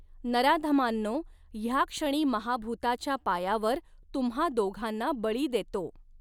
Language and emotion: Marathi, neutral